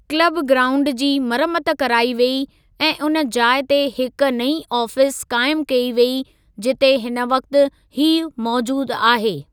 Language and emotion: Sindhi, neutral